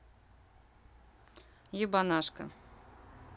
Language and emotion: Russian, neutral